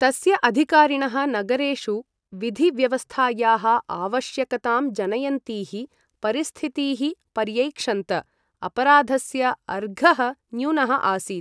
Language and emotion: Sanskrit, neutral